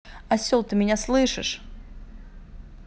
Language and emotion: Russian, angry